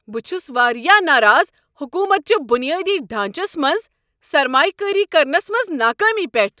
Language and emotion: Kashmiri, angry